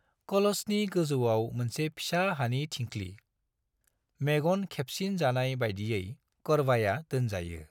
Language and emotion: Bodo, neutral